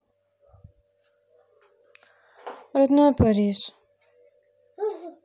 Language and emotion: Russian, sad